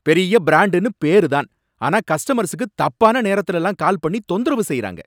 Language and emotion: Tamil, angry